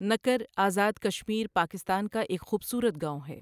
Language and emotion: Urdu, neutral